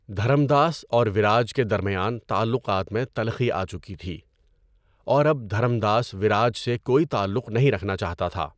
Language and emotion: Urdu, neutral